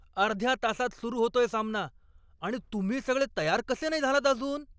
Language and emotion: Marathi, angry